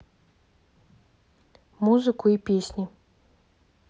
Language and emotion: Russian, neutral